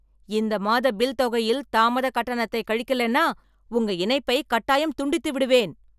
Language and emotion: Tamil, angry